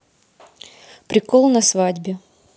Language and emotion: Russian, neutral